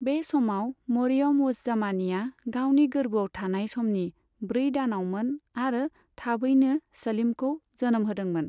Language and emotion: Bodo, neutral